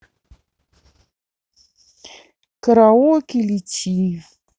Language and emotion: Russian, neutral